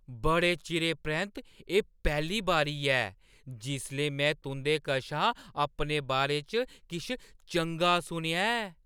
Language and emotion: Dogri, surprised